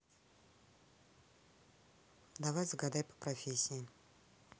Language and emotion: Russian, neutral